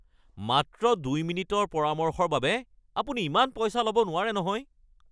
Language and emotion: Assamese, angry